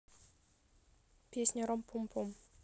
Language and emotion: Russian, neutral